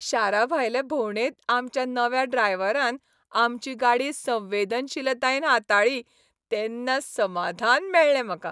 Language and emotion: Goan Konkani, happy